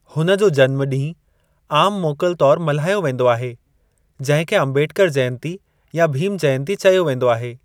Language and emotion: Sindhi, neutral